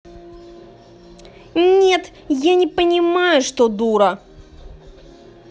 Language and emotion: Russian, angry